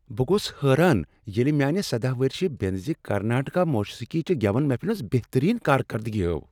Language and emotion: Kashmiri, surprised